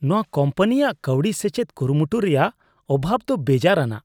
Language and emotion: Santali, disgusted